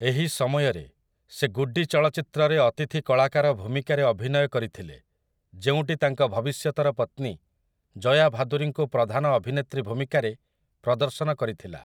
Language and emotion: Odia, neutral